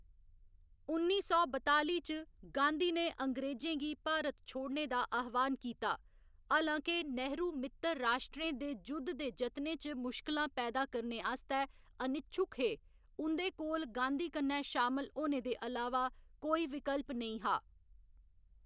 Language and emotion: Dogri, neutral